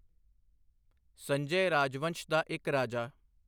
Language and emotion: Punjabi, neutral